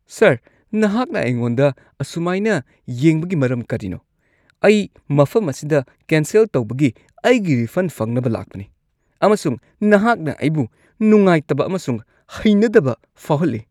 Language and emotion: Manipuri, disgusted